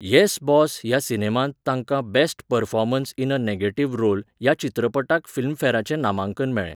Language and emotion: Goan Konkani, neutral